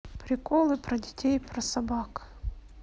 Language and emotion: Russian, neutral